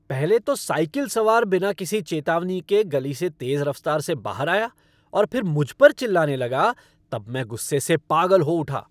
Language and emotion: Hindi, angry